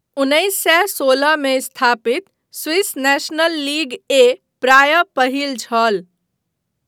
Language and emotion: Maithili, neutral